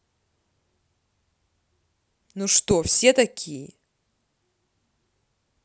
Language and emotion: Russian, angry